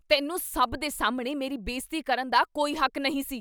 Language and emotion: Punjabi, angry